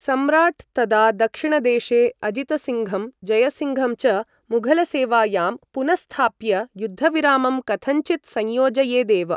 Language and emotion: Sanskrit, neutral